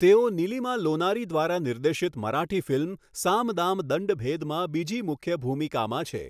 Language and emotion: Gujarati, neutral